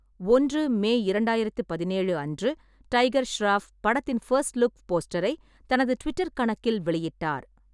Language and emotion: Tamil, neutral